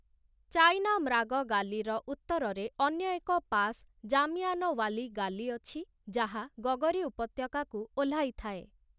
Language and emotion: Odia, neutral